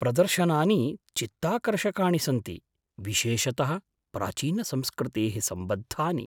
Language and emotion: Sanskrit, surprised